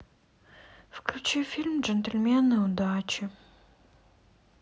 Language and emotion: Russian, sad